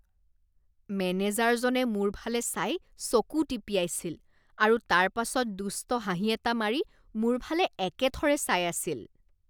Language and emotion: Assamese, disgusted